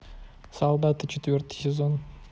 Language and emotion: Russian, neutral